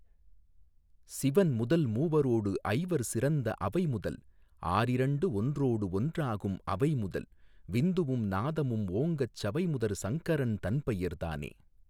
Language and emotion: Tamil, neutral